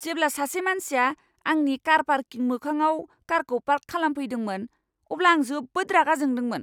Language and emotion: Bodo, angry